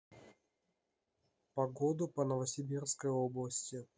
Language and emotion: Russian, neutral